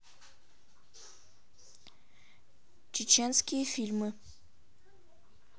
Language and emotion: Russian, neutral